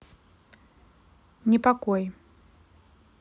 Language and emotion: Russian, neutral